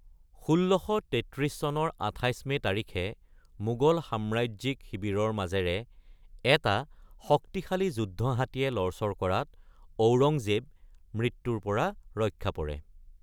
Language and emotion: Assamese, neutral